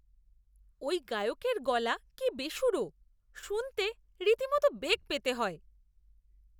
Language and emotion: Bengali, disgusted